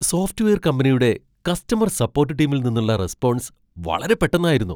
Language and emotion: Malayalam, surprised